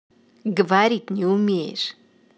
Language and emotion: Russian, angry